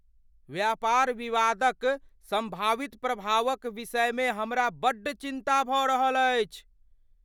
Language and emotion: Maithili, fearful